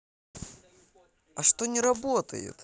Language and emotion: Russian, positive